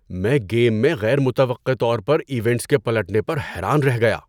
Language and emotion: Urdu, surprised